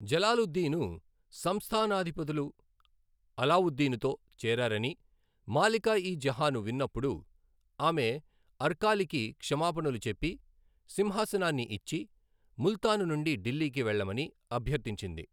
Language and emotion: Telugu, neutral